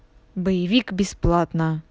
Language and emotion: Russian, angry